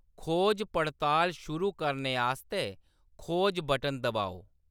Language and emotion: Dogri, neutral